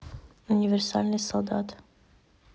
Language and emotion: Russian, neutral